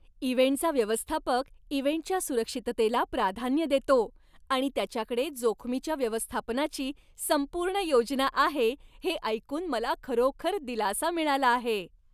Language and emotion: Marathi, happy